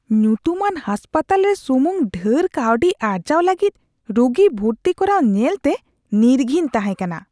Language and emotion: Santali, disgusted